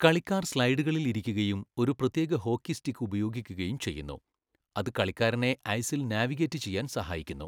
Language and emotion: Malayalam, neutral